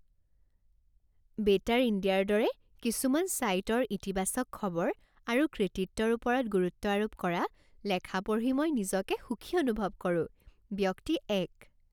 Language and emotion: Assamese, happy